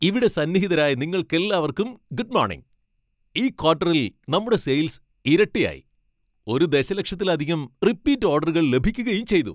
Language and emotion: Malayalam, happy